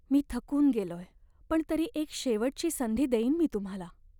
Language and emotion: Marathi, sad